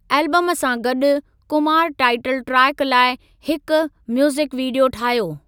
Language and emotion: Sindhi, neutral